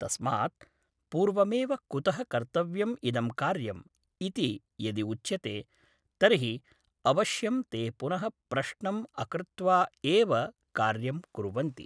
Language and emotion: Sanskrit, neutral